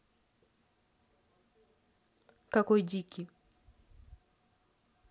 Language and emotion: Russian, neutral